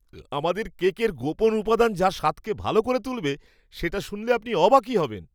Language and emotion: Bengali, surprised